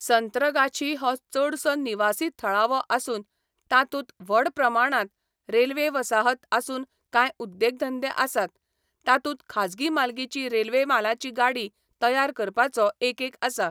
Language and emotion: Goan Konkani, neutral